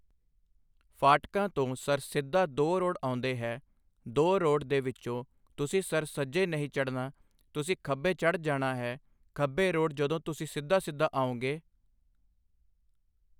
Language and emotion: Punjabi, neutral